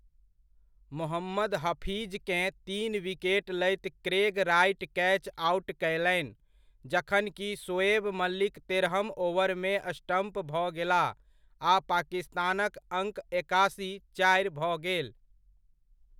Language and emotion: Maithili, neutral